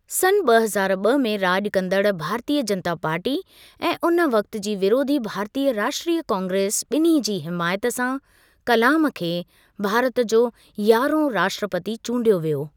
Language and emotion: Sindhi, neutral